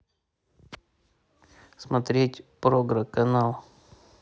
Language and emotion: Russian, neutral